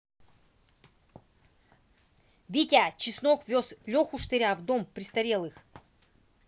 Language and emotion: Russian, angry